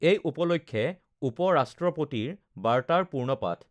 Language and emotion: Assamese, neutral